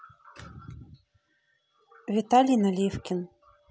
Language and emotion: Russian, neutral